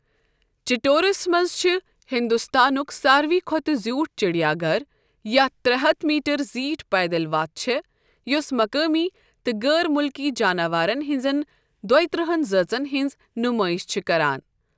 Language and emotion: Kashmiri, neutral